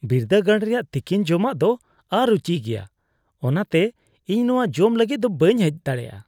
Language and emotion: Santali, disgusted